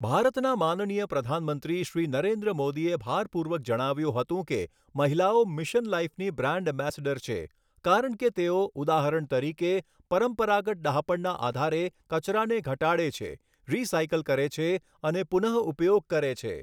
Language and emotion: Gujarati, neutral